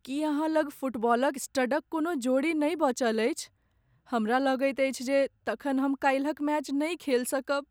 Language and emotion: Maithili, sad